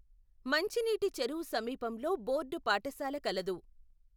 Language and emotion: Telugu, neutral